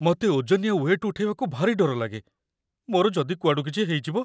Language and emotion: Odia, fearful